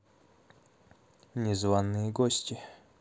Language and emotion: Russian, neutral